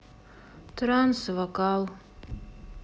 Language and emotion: Russian, sad